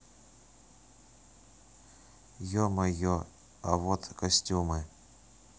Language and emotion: Russian, neutral